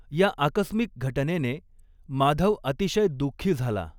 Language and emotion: Marathi, neutral